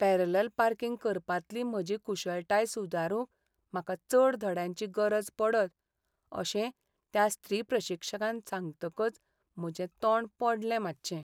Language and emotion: Goan Konkani, sad